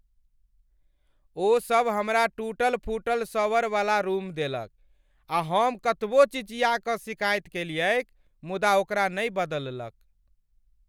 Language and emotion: Maithili, angry